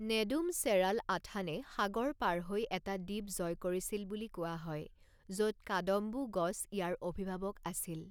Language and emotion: Assamese, neutral